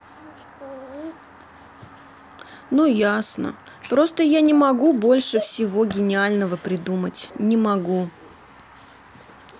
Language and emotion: Russian, sad